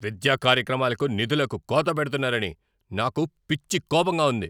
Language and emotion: Telugu, angry